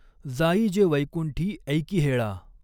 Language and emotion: Marathi, neutral